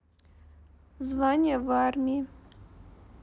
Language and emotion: Russian, neutral